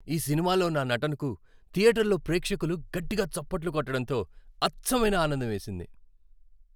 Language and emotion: Telugu, happy